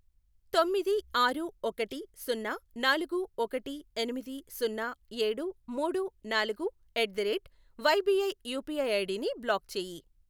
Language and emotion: Telugu, neutral